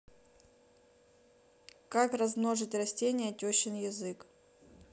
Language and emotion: Russian, neutral